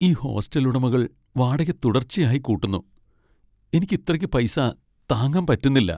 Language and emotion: Malayalam, sad